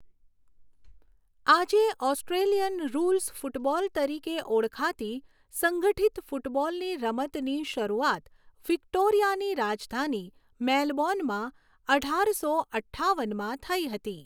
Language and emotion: Gujarati, neutral